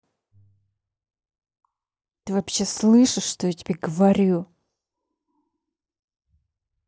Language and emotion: Russian, angry